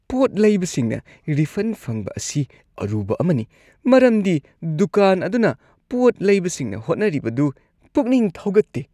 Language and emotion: Manipuri, disgusted